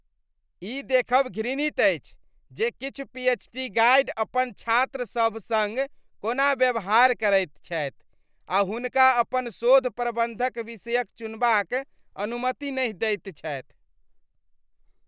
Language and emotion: Maithili, disgusted